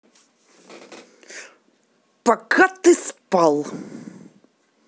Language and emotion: Russian, angry